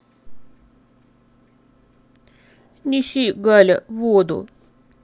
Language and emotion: Russian, sad